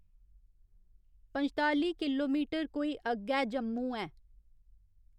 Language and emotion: Dogri, neutral